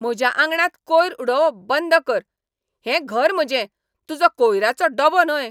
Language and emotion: Goan Konkani, angry